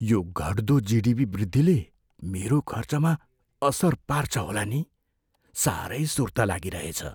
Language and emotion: Nepali, fearful